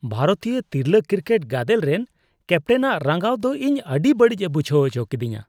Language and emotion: Santali, disgusted